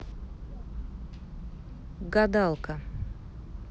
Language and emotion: Russian, neutral